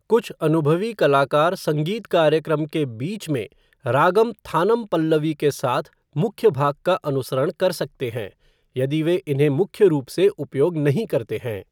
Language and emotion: Hindi, neutral